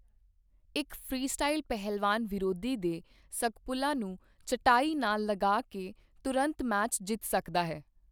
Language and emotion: Punjabi, neutral